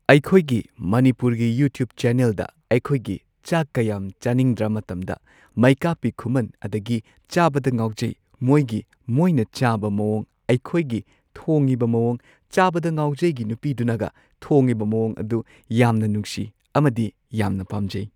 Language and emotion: Manipuri, neutral